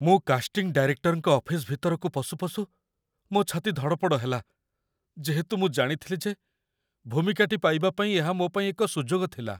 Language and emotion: Odia, fearful